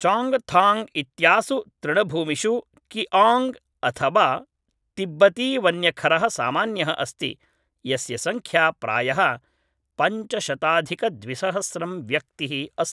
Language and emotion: Sanskrit, neutral